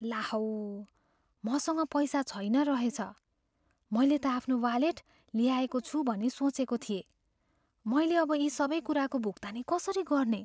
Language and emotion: Nepali, fearful